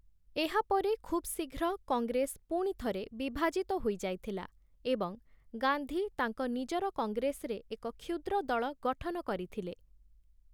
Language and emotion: Odia, neutral